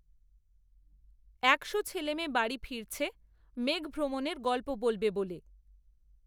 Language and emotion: Bengali, neutral